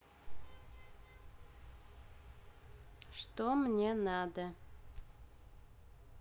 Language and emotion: Russian, neutral